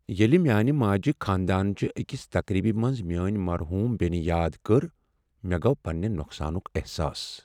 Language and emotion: Kashmiri, sad